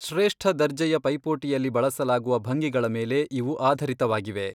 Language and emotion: Kannada, neutral